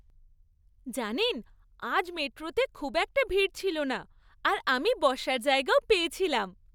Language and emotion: Bengali, happy